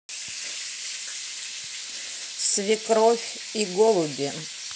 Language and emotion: Russian, neutral